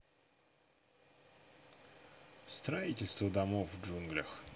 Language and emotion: Russian, neutral